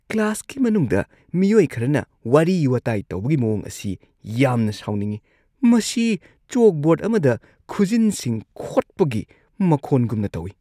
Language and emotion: Manipuri, disgusted